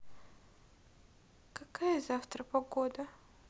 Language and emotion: Russian, sad